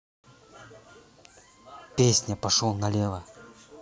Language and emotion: Russian, neutral